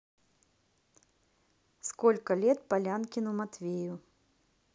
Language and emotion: Russian, neutral